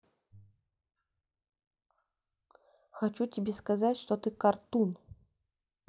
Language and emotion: Russian, neutral